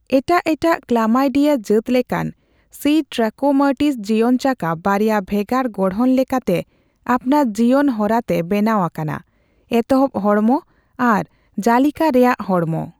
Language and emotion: Santali, neutral